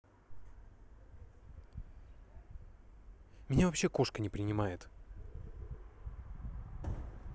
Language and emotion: Russian, neutral